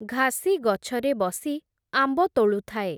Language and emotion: Odia, neutral